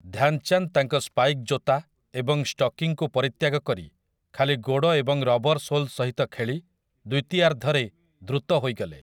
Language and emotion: Odia, neutral